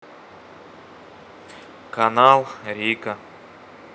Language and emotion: Russian, neutral